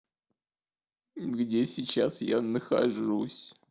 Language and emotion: Russian, sad